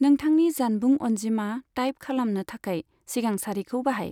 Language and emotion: Bodo, neutral